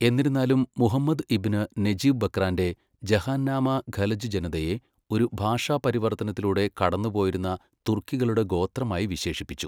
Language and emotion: Malayalam, neutral